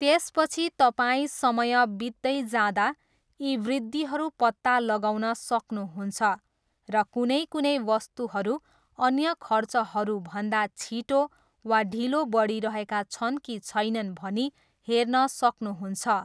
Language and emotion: Nepali, neutral